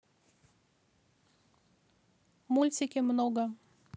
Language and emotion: Russian, neutral